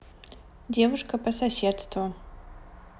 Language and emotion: Russian, neutral